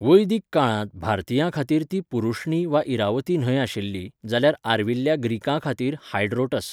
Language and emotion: Goan Konkani, neutral